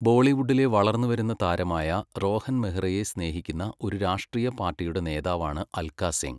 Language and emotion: Malayalam, neutral